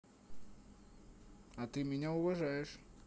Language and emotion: Russian, positive